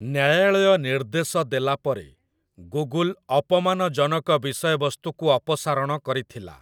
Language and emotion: Odia, neutral